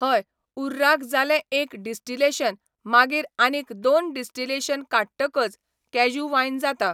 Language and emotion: Goan Konkani, neutral